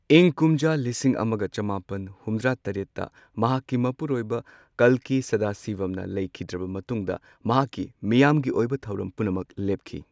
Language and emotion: Manipuri, neutral